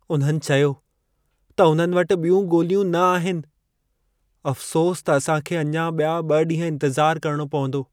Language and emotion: Sindhi, sad